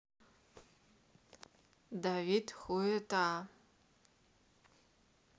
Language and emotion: Russian, neutral